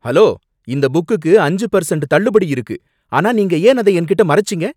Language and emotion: Tamil, angry